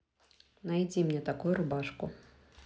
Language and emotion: Russian, neutral